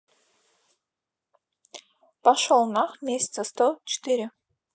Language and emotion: Russian, neutral